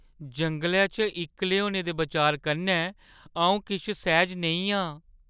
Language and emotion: Dogri, fearful